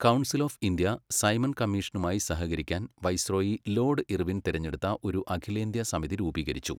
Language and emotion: Malayalam, neutral